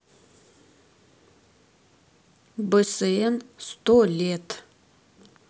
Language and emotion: Russian, neutral